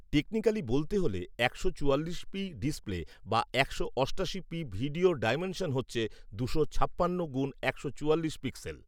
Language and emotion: Bengali, neutral